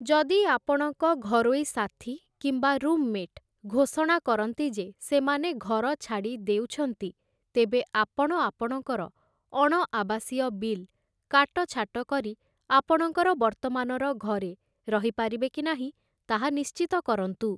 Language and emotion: Odia, neutral